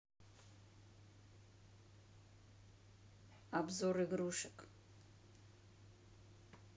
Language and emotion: Russian, neutral